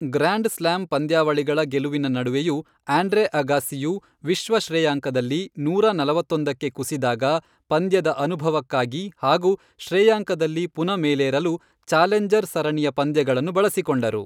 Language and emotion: Kannada, neutral